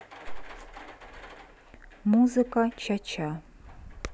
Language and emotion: Russian, neutral